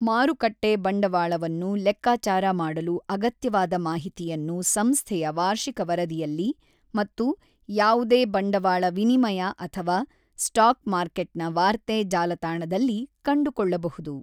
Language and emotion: Kannada, neutral